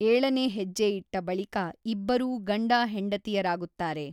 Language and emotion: Kannada, neutral